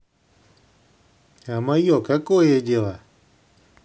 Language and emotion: Russian, neutral